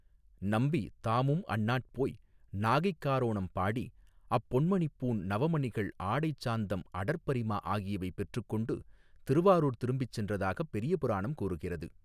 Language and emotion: Tamil, neutral